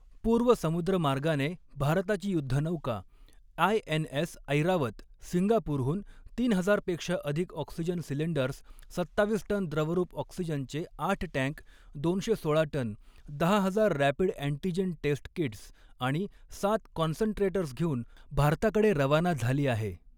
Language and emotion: Marathi, neutral